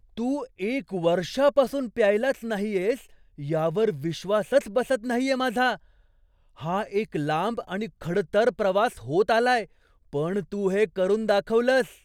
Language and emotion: Marathi, surprised